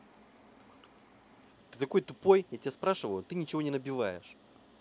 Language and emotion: Russian, angry